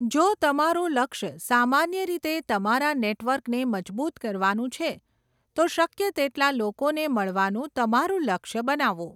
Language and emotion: Gujarati, neutral